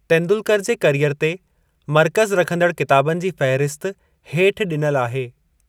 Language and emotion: Sindhi, neutral